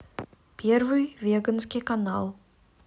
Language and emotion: Russian, neutral